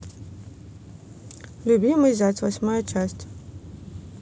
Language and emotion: Russian, neutral